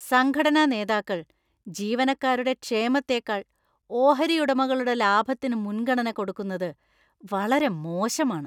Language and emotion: Malayalam, disgusted